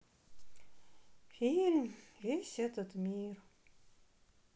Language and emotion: Russian, neutral